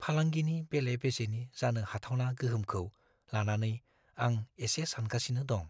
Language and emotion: Bodo, fearful